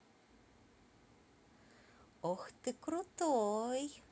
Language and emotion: Russian, positive